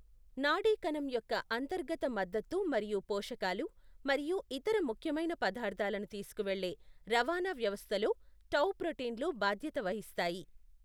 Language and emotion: Telugu, neutral